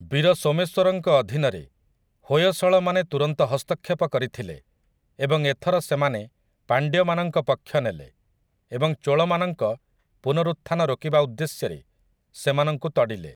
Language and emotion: Odia, neutral